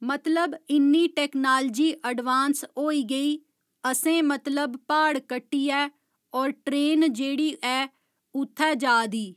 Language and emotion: Dogri, neutral